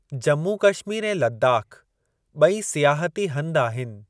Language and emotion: Sindhi, neutral